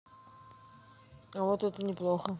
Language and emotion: Russian, neutral